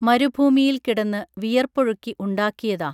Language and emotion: Malayalam, neutral